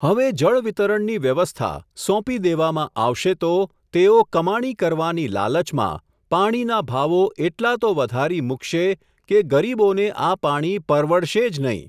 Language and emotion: Gujarati, neutral